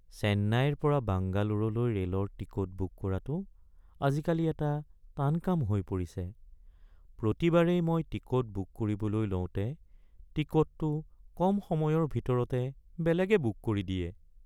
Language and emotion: Assamese, sad